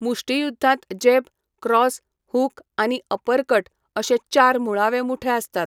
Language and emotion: Goan Konkani, neutral